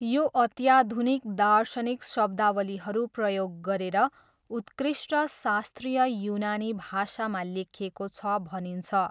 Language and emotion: Nepali, neutral